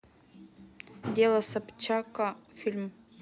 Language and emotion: Russian, neutral